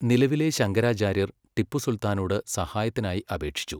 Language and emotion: Malayalam, neutral